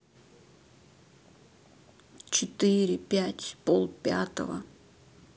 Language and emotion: Russian, neutral